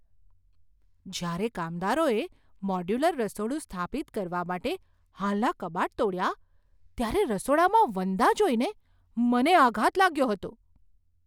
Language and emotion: Gujarati, surprised